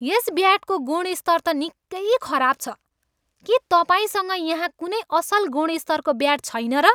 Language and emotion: Nepali, angry